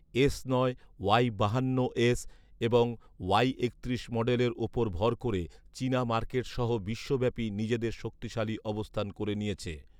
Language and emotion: Bengali, neutral